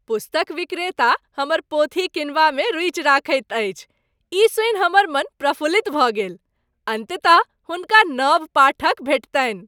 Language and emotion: Maithili, happy